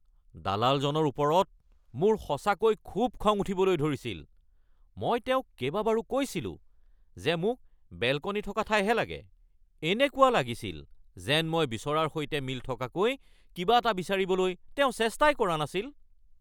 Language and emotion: Assamese, angry